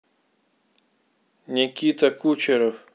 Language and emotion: Russian, neutral